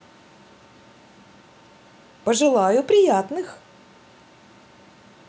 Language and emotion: Russian, positive